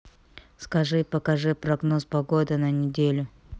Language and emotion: Russian, neutral